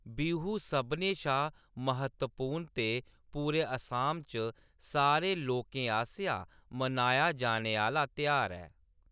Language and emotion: Dogri, neutral